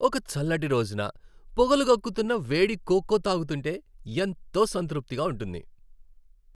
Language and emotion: Telugu, happy